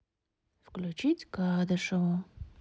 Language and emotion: Russian, neutral